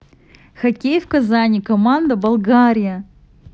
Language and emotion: Russian, positive